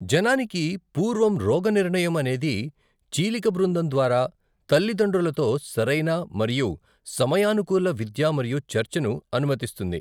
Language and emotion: Telugu, neutral